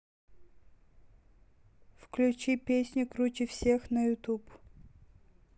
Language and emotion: Russian, neutral